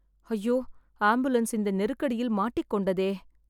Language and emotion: Tamil, sad